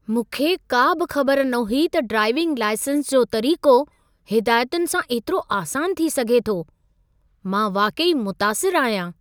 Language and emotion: Sindhi, surprised